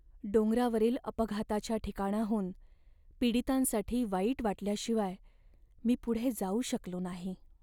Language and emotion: Marathi, sad